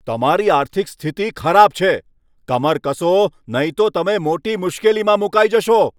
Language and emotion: Gujarati, angry